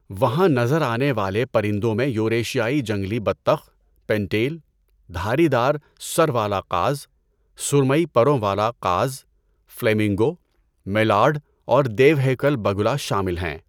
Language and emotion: Urdu, neutral